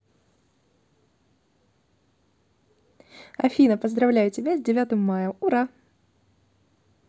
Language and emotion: Russian, positive